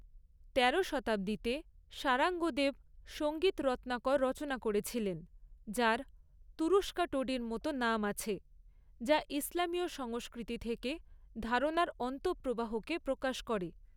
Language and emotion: Bengali, neutral